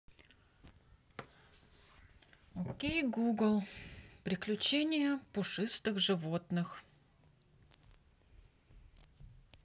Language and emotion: Russian, neutral